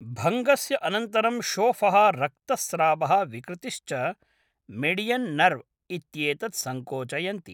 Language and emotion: Sanskrit, neutral